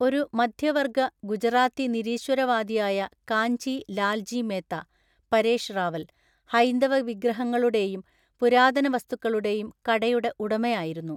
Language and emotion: Malayalam, neutral